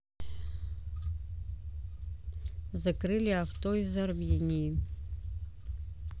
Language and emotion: Russian, neutral